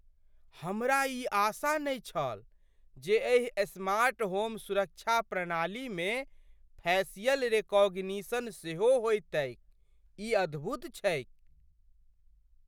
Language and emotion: Maithili, surprised